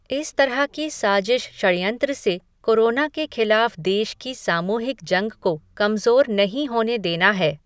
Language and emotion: Hindi, neutral